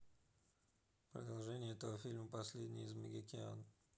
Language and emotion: Russian, neutral